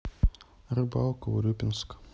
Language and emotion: Russian, sad